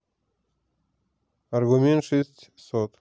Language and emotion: Russian, neutral